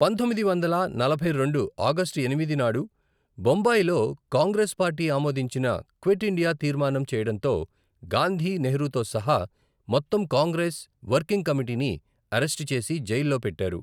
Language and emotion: Telugu, neutral